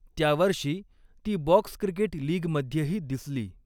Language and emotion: Marathi, neutral